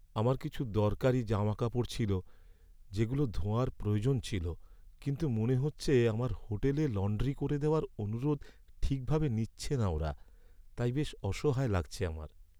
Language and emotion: Bengali, sad